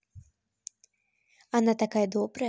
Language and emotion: Russian, positive